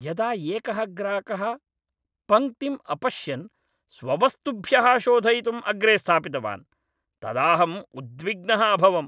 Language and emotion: Sanskrit, angry